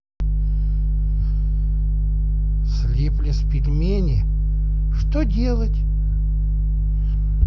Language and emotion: Russian, neutral